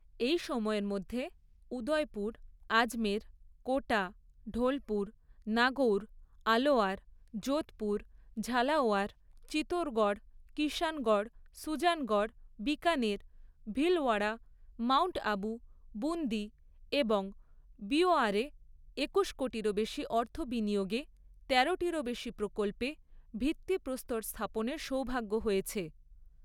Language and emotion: Bengali, neutral